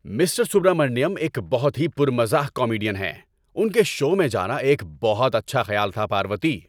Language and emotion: Urdu, happy